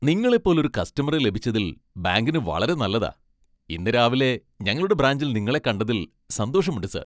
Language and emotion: Malayalam, happy